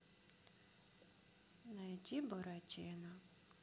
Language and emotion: Russian, sad